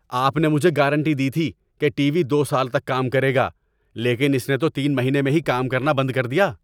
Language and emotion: Urdu, angry